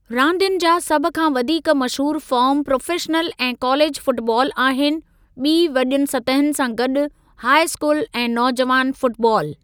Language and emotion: Sindhi, neutral